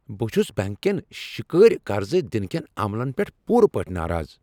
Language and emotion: Kashmiri, angry